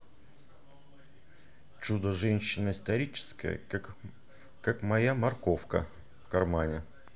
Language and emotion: Russian, neutral